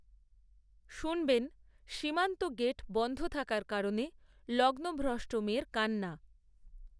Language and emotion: Bengali, neutral